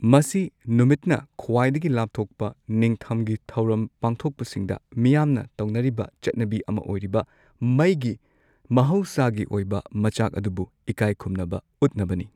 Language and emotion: Manipuri, neutral